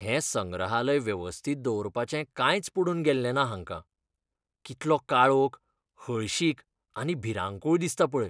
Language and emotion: Goan Konkani, disgusted